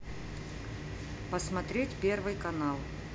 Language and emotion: Russian, neutral